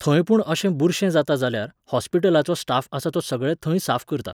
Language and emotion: Goan Konkani, neutral